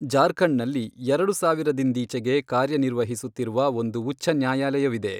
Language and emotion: Kannada, neutral